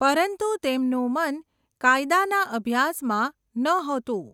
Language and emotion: Gujarati, neutral